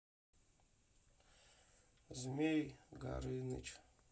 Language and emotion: Russian, sad